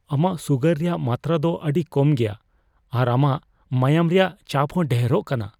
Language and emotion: Santali, fearful